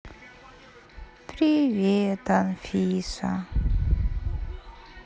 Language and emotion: Russian, sad